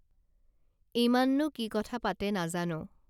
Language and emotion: Assamese, neutral